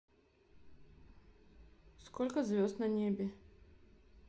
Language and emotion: Russian, neutral